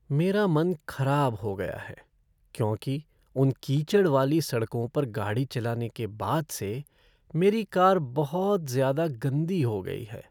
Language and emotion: Hindi, sad